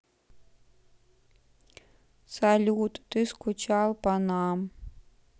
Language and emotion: Russian, sad